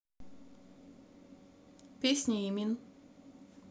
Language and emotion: Russian, neutral